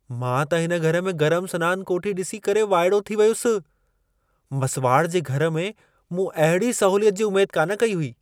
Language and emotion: Sindhi, surprised